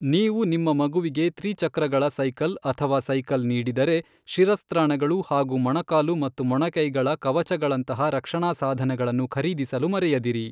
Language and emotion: Kannada, neutral